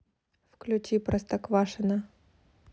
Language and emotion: Russian, neutral